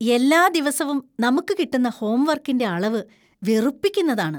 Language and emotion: Malayalam, disgusted